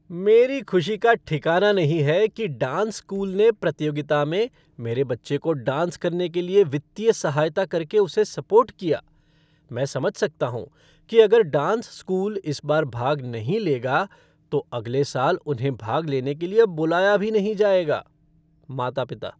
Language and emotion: Hindi, happy